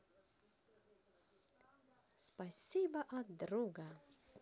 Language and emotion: Russian, positive